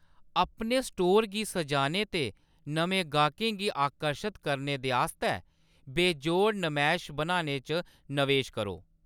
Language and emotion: Dogri, neutral